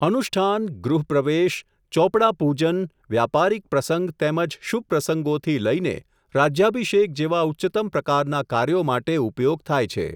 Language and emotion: Gujarati, neutral